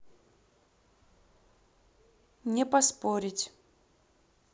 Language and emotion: Russian, neutral